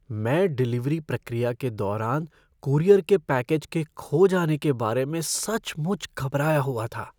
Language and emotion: Hindi, fearful